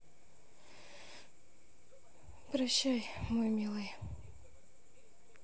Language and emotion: Russian, sad